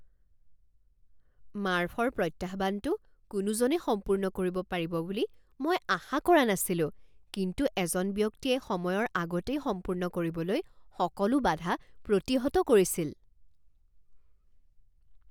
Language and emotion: Assamese, surprised